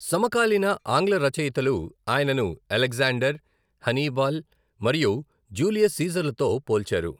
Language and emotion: Telugu, neutral